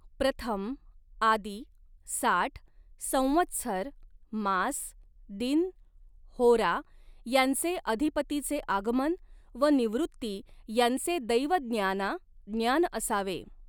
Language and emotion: Marathi, neutral